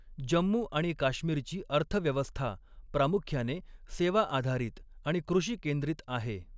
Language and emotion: Marathi, neutral